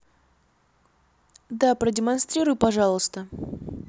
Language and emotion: Russian, neutral